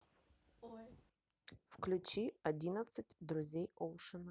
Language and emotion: Russian, neutral